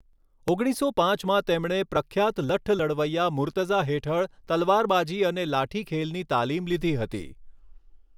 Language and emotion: Gujarati, neutral